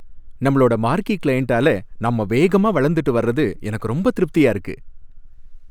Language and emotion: Tamil, happy